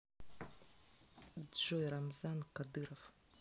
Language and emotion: Russian, neutral